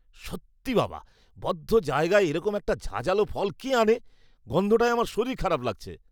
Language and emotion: Bengali, disgusted